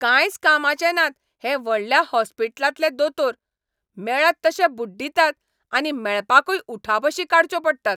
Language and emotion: Goan Konkani, angry